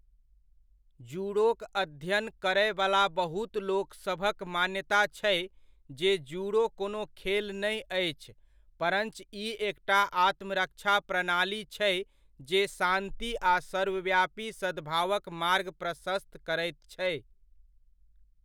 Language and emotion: Maithili, neutral